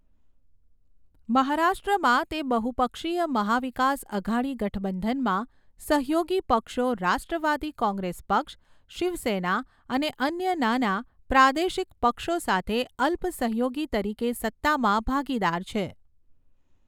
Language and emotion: Gujarati, neutral